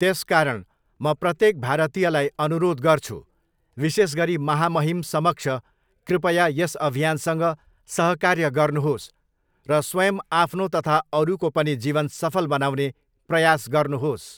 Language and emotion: Nepali, neutral